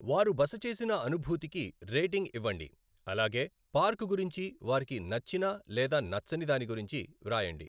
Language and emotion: Telugu, neutral